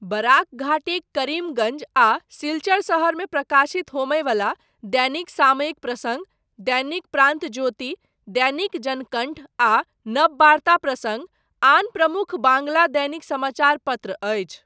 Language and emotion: Maithili, neutral